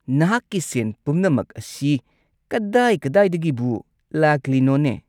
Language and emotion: Manipuri, angry